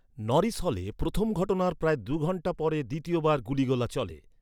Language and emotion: Bengali, neutral